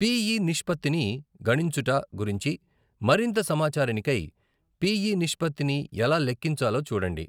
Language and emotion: Telugu, neutral